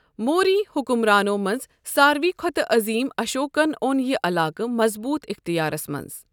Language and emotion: Kashmiri, neutral